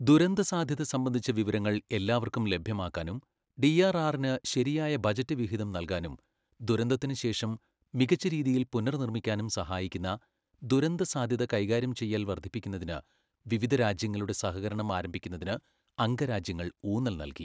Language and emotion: Malayalam, neutral